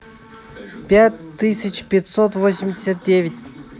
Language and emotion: Russian, neutral